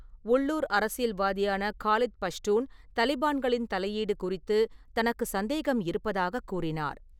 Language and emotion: Tamil, neutral